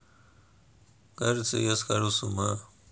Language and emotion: Russian, sad